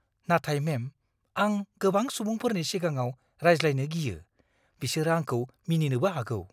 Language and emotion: Bodo, fearful